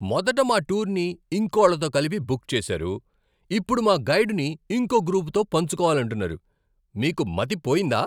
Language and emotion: Telugu, angry